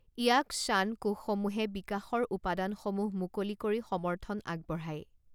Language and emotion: Assamese, neutral